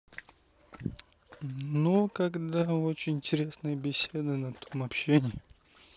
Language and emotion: Russian, neutral